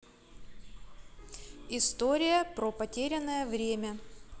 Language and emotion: Russian, neutral